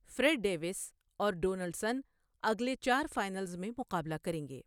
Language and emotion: Urdu, neutral